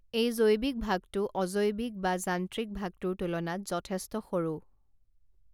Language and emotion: Assamese, neutral